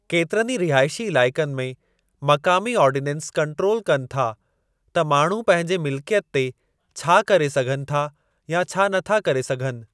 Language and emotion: Sindhi, neutral